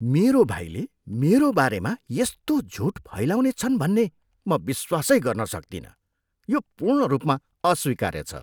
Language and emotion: Nepali, disgusted